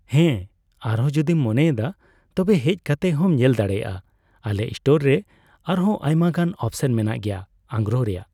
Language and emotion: Santali, neutral